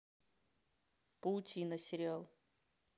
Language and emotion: Russian, neutral